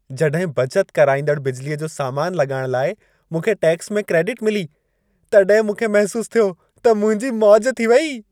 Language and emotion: Sindhi, happy